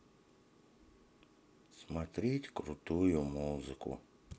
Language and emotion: Russian, sad